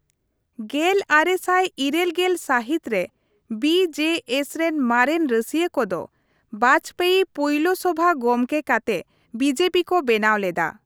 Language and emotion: Santali, neutral